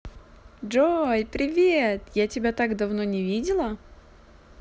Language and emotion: Russian, positive